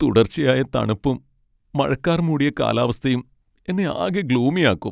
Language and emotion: Malayalam, sad